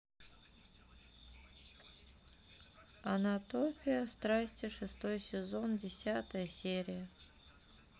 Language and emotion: Russian, sad